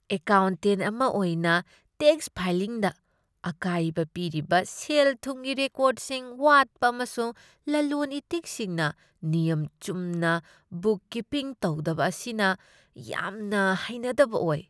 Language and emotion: Manipuri, disgusted